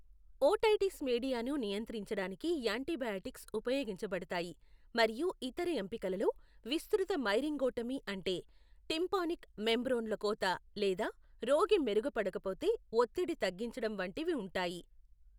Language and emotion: Telugu, neutral